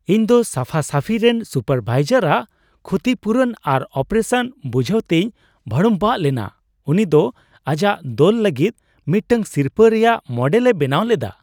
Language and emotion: Santali, surprised